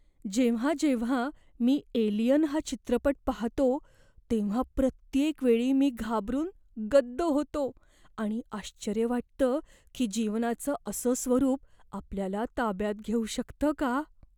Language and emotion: Marathi, fearful